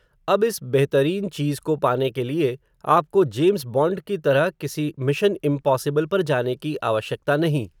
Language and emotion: Hindi, neutral